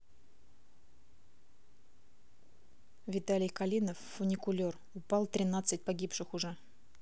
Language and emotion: Russian, neutral